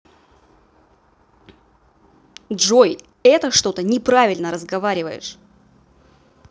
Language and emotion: Russian, angry